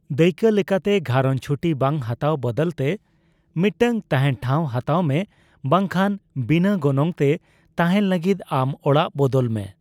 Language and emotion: Santali, neutral